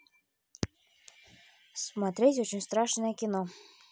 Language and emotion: Russian, neutral